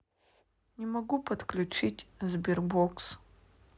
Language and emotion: Russian, sad